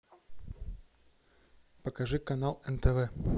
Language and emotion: Russian, neutral